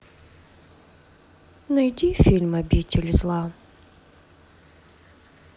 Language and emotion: Russian, sad